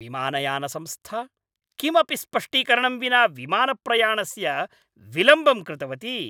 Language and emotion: Sanskrit, angry